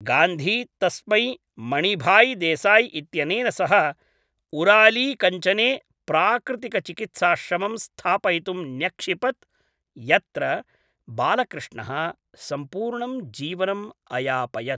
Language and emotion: Sanskrit, neutral